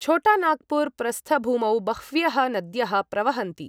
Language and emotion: Sanskrit, neutral